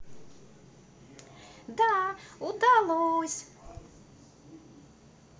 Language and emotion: Russian, positive